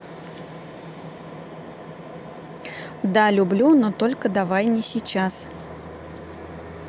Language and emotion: Russian, neutral